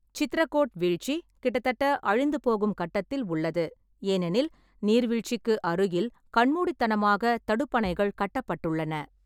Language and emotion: Tamil, neutral